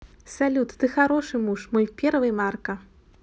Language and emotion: Russian, neutral